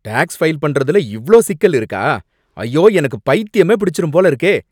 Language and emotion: Tamil, angry